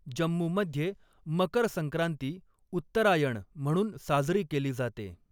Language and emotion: Marathi, neutral